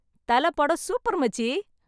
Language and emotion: Tamil, happy